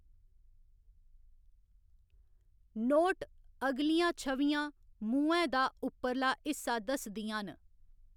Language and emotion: Dogri, neutral